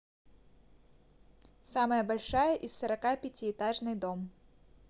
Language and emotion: Russian, neutral